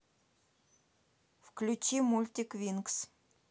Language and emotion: Russian, neutral